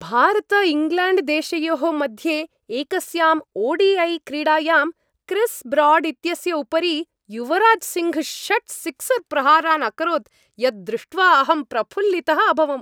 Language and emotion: Sanskrit, happy